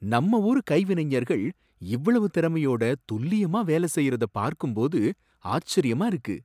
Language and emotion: Tamil, surprised